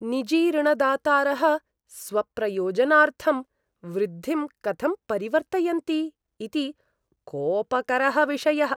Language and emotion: Sanskrit, disgusted